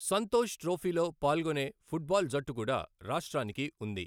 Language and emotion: Telugu, neutral